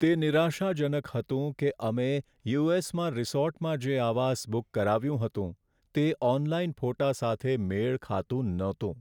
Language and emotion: Gujarati, sad